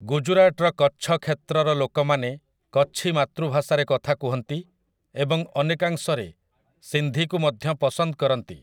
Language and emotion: Odia, neutral